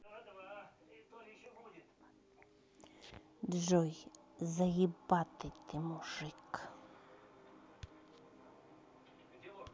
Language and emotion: Russian, neutral